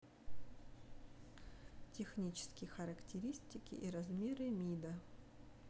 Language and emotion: Russian, neutral